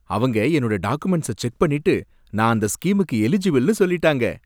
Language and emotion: Tamil, happy